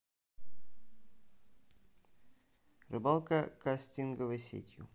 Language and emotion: Russian, neutral